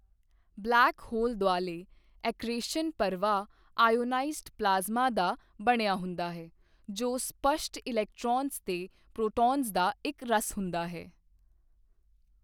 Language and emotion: Punjabi, neutral